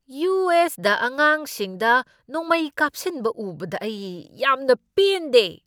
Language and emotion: Manipuri, angry